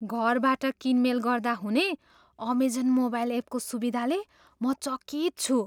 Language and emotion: Nepali, surprised